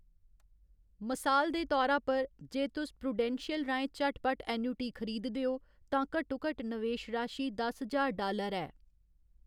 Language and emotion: Dogri, neutral